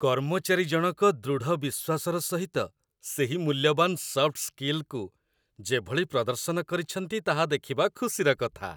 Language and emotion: Odia, happy